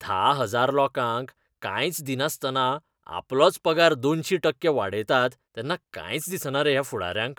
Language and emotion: Goan Konkani, disgusted